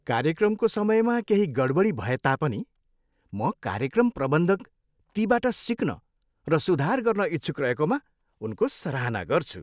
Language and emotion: Nepali, happy